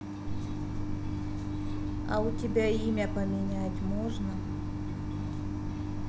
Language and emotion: Russian, neutral